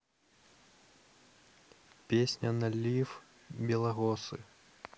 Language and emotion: Russian, neutral